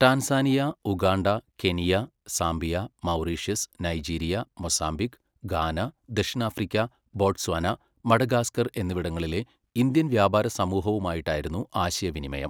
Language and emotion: Malayalam, neutral